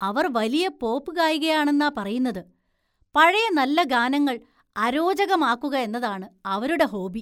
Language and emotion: Malayalam, disgusted